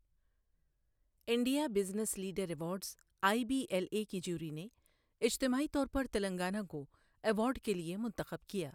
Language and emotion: Urdu, neutral